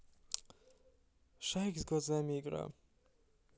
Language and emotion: Russian, sad